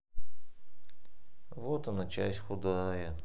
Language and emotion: Russian, sad